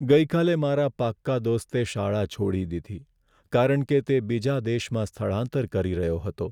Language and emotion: Gujarati, sad